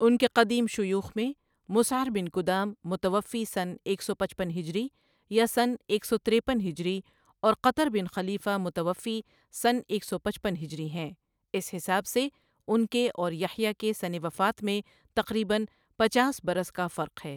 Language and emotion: Urdu, neutral